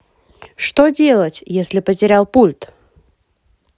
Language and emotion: Russian, positive